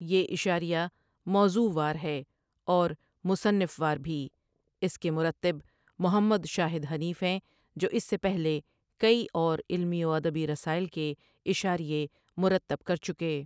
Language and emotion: Urdu, neutral